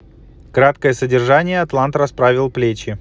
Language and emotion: Russian, neutral